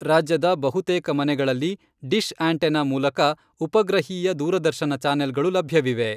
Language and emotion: Kannada, neutral